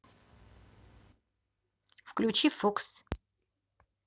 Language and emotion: Russian, neutral